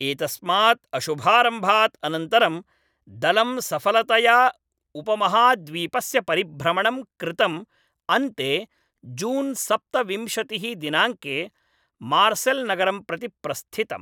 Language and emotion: Sanskrit, neutral